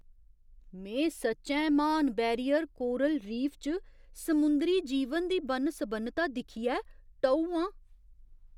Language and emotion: Dogri, surprised